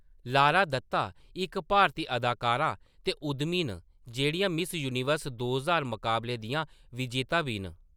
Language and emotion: Dogri, neutral